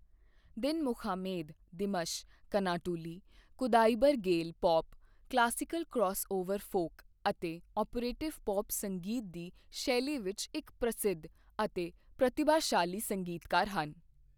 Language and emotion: Punjabi, neutral